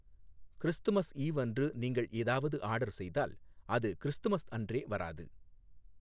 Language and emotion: Tamil, neutral